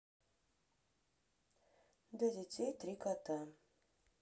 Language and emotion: Russian, neutral